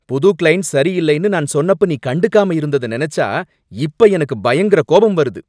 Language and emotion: Tamil, angry